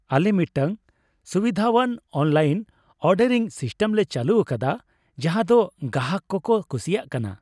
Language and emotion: Santali, happy